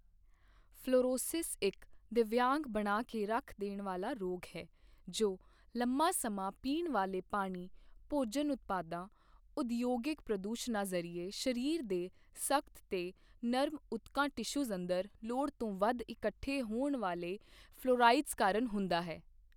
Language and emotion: Punjabi, neutral